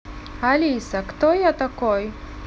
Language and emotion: Russian, neutral